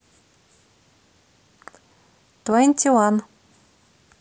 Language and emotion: Russian, neutral